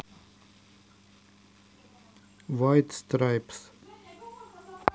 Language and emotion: Russian, neutral